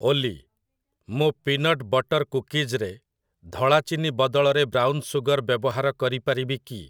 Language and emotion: Odia, neutral